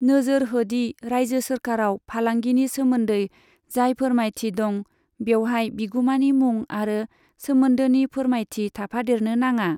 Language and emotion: Bodo, neutral